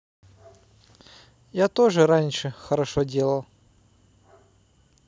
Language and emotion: Russian, neutral